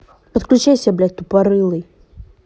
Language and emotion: Russian, angry